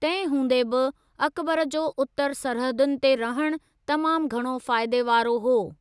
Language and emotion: Sindhi, neutral